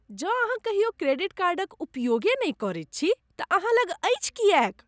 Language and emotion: Maithili, disgusted